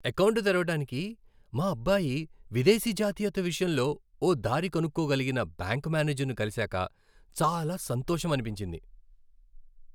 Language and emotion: Telugu, happy